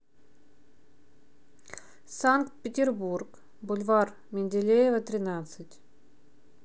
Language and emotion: Russian, neutral